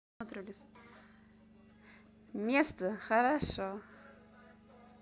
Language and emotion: Russian, positive